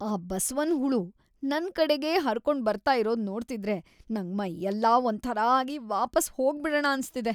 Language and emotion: Kannada, disgusted